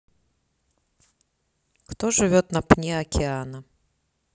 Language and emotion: Russian, neutral